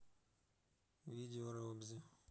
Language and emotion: Russian, neutral